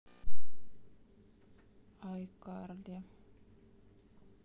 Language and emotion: Russian, sad